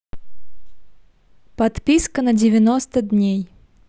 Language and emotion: Russian, neutral